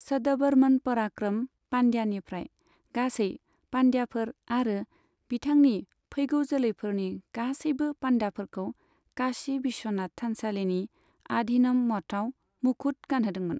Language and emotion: Bodo, neutral